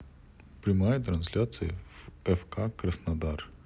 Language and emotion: Russian, neutral